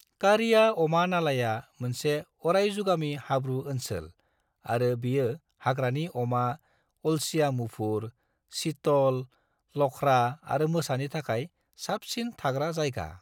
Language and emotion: Bodo, neutral